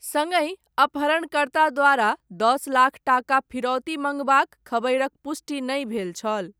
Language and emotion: Maithili, neutral